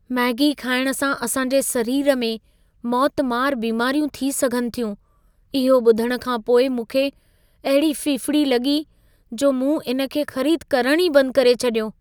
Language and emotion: Sindhi, fearful